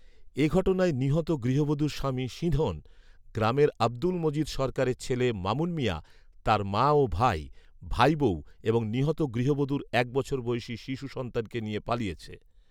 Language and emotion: Bengali, neutral